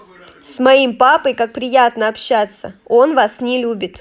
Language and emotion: Russian, positive